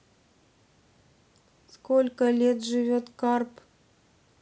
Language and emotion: Russian, neutral